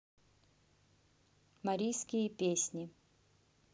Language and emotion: Russian, neutral